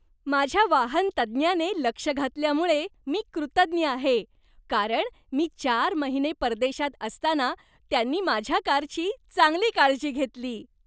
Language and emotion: Marathi, happy